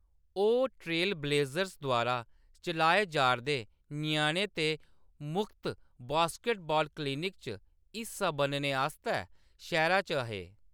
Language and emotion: Dogri, neutral